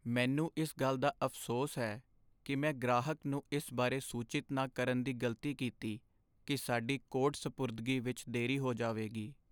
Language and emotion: Punjabi, sad